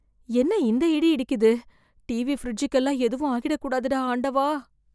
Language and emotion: Tamil, fearful